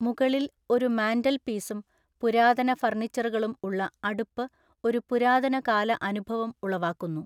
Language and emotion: Malayalam, neutral